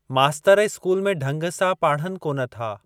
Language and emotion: Sindhi, neutral